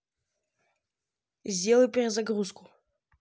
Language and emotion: Russian, neutral